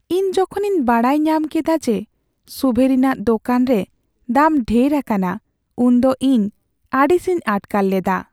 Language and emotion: Santali, sad